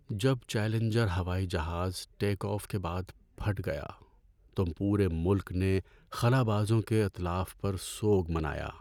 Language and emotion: Urdu, sad